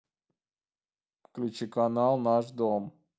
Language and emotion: Russian, neutral